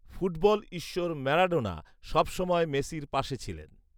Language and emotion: Bengali, neutral